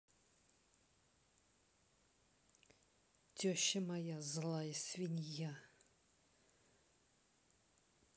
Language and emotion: Russian, angry